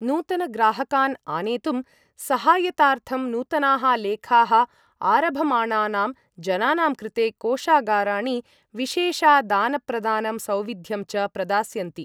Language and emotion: Sanskrit, neutral